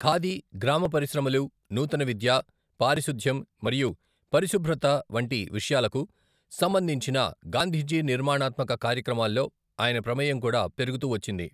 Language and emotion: Telugu, neutral